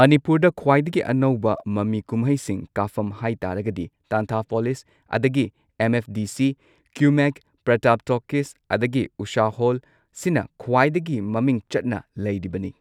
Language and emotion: Manipuri, neutral